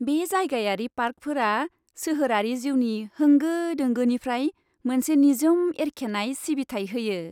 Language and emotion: Bodo, happy